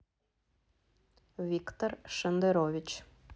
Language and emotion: Russian, neutral